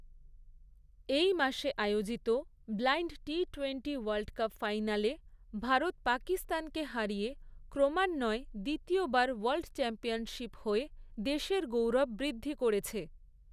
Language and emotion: Bengali, neutral